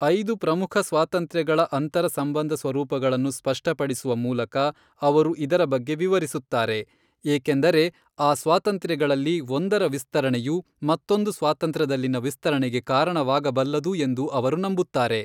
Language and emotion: Kannada, neutral